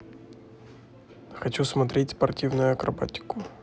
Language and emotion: Russian, neutral